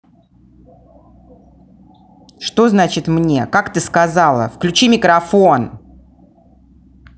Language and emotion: Russian, angry